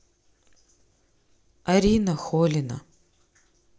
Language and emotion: Russian, neutral